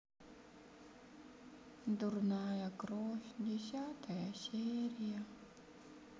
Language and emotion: Russian, sad